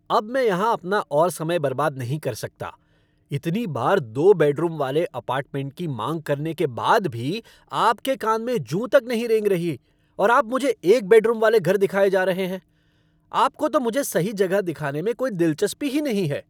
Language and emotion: Hindi, angry